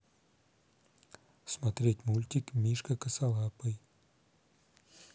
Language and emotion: Russian, neutral